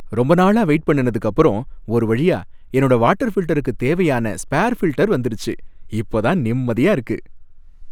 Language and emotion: Tamil, happy